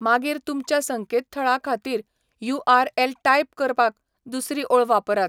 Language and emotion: Goan Konkani, neutral